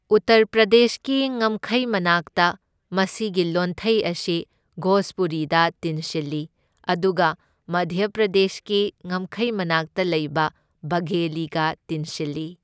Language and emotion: Manipuri, neutral